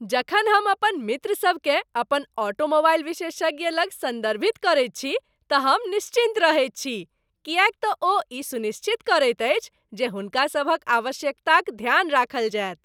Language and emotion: Maithili, happy